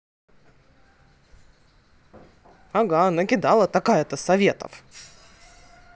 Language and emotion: Russian, angry